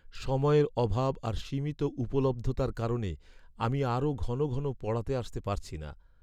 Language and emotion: Bengali, sad